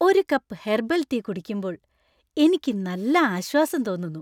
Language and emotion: Malayalam, happy